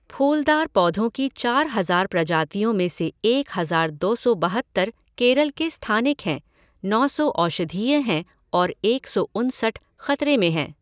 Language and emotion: Hindi, neutral